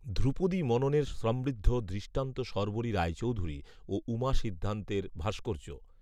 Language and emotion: Bengali, neutral